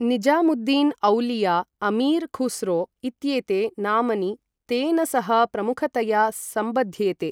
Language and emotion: Sanskrit, neutral